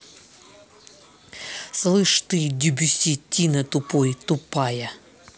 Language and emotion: Russian, angry